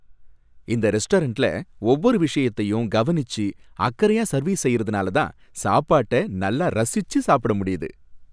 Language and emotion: Tamil, happy